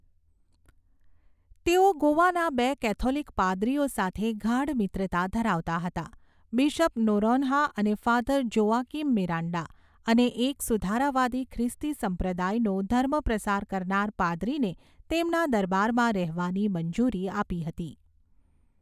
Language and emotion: Gujarati, neutral